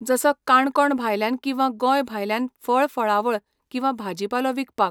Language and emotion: Goan Konkani, neutral